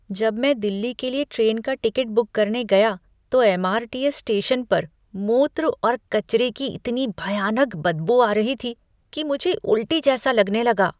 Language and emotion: Hindi, disgusted